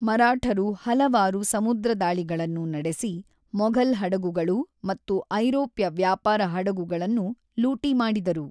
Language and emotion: Kannada, neutral